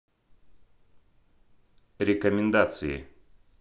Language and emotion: Russian, neutral